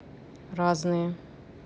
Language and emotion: Russian, neutral